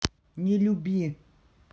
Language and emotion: Russian, neutral